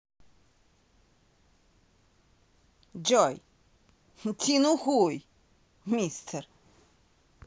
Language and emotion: Russian, angry